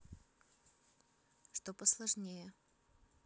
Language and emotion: Russian, neutral